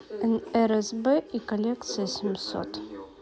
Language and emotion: Russian, neutral